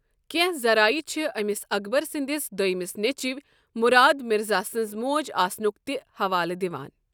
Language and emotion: Kashmiri, neutral